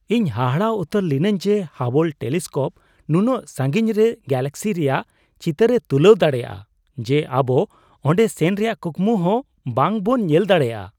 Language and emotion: Santali, surprised